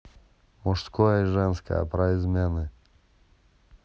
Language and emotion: Russian, neutral